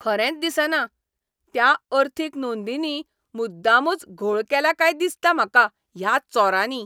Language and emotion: Goan Konkani, angry